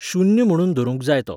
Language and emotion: Goan Konkani, neutral